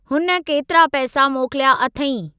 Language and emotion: Sindhi, neutral